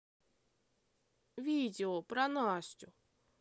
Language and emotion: Russian, neutral